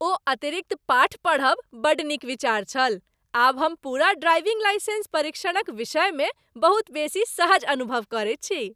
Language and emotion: Maithili, happy